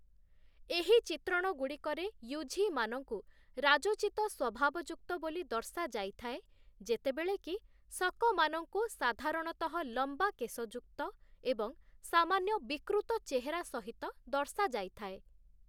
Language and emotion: Odia, neutral